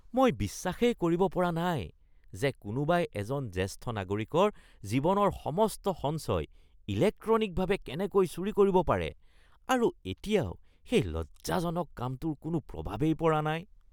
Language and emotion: Assamese, disgusted